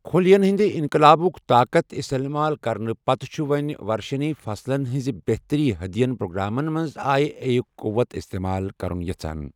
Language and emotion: Kashmiri, neutral